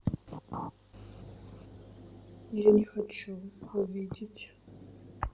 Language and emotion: Russian, sad